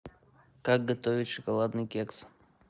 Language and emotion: Russian, neutral